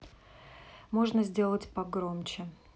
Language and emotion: Russian, neutral